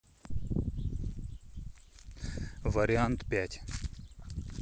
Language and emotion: Russian, neutral